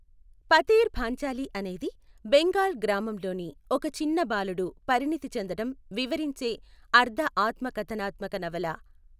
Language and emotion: Telugu, neutral